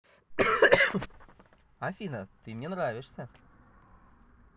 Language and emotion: Russian, positive